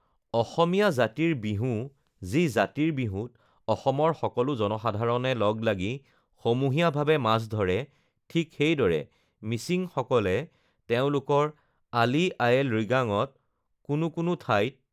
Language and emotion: Assamese, neutral